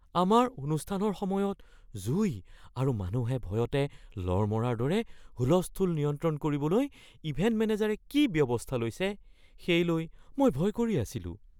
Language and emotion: Assamese, fearful